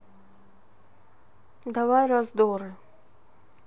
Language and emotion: Russian, neutral